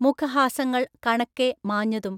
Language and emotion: Malayalam, neutral